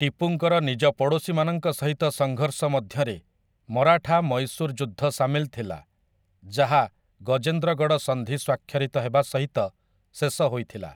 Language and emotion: Odia, neutral